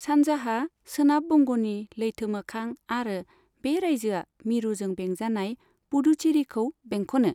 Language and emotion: Bodo, neutral